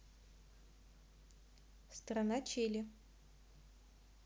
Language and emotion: Russian, neutral